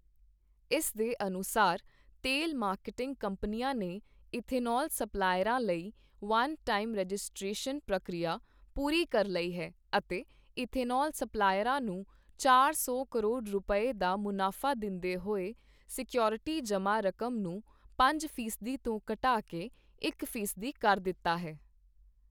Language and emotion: Punjabi, neutral